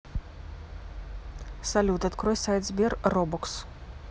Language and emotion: Russian, neutral